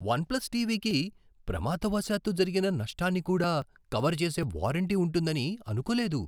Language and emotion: Telugu, surprised